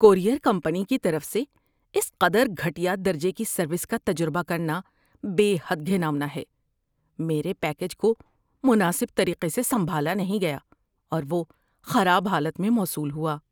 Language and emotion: Urdu, disgusted